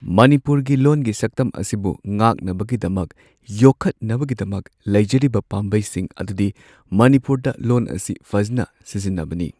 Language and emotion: Manipuri, neutral